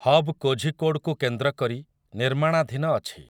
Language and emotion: Odia, neutral